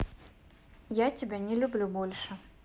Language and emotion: Russian, neutral